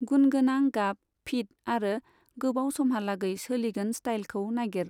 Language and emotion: Bodo, neutral